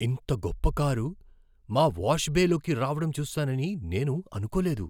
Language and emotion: Telugu, surprised